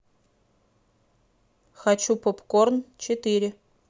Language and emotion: Russian, neutral